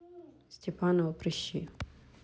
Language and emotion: Russian, neutral